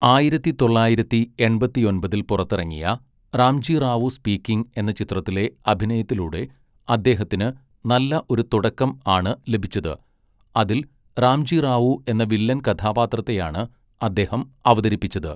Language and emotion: Malayalam, neutral